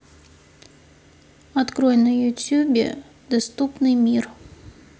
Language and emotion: Russian, neutral